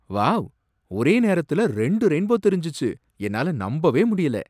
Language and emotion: Tamil, surprised